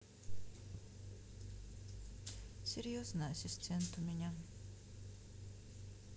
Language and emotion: Russian, sad